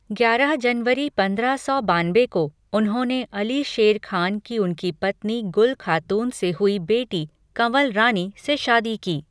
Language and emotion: Hindi, neutral